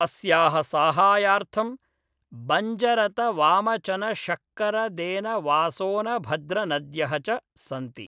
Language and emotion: Sanskrit, neutral